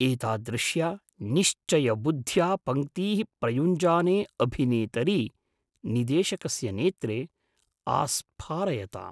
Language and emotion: Sanskrit, surprised